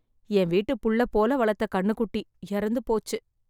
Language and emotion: Tamil, sad